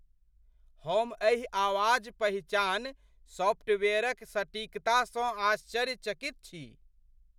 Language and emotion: Maithili, surprised